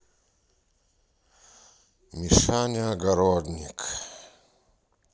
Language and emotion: Russian, sad